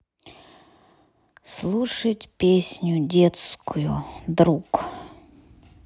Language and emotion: Russian, sad